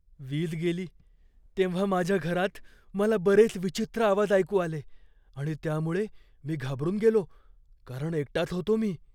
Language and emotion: Marathi, fearful